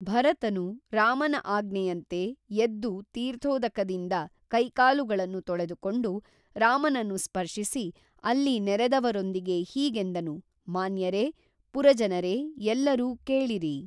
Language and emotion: Kannada, neutral